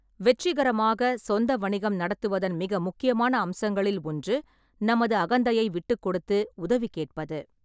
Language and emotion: Tamil, neutral